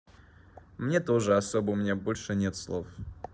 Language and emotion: Russian, neutral